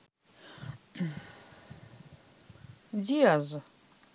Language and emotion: Russian, neutral